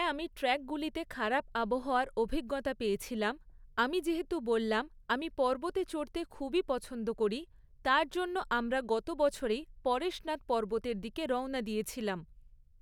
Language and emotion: Bengali, neutral